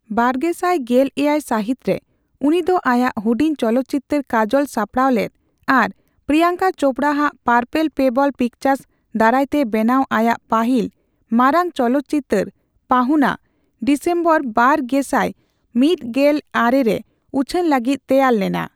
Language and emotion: Santali, neutral